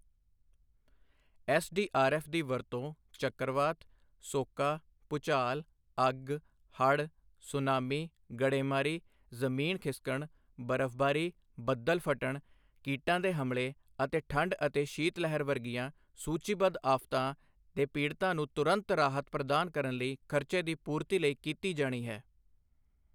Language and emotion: Punjabi, neutral